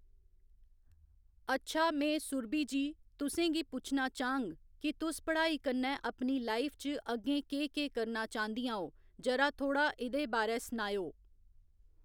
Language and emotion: Dogri, neutral